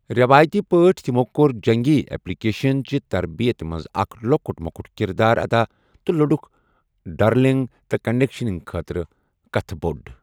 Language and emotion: Kashmiri, neutral